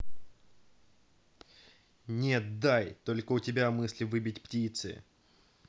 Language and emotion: Russian, angry